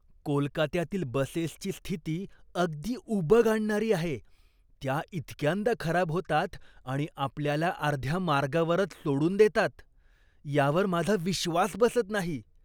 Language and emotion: Marathi, disgusted